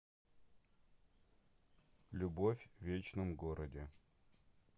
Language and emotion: Russian, neutral